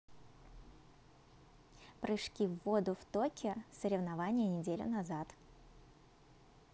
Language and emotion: Russian, positive